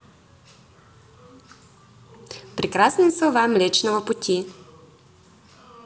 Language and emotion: Russian, positive